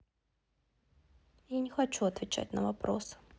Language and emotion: Russian, sad